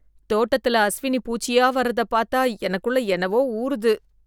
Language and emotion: Tamil, disgusted